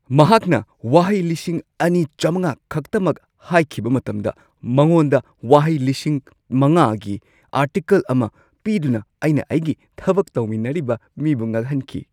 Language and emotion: Manipuri, surprised